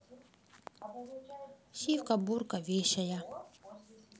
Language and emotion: Russian, neutral